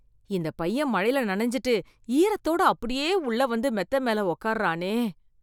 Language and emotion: Tamil, disgusted